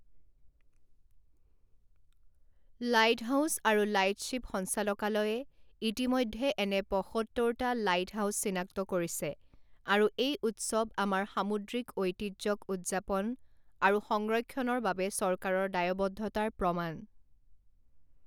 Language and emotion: Assamese, neutral